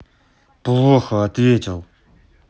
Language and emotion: Russian, angry